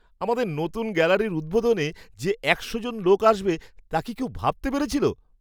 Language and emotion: Bengali, surprised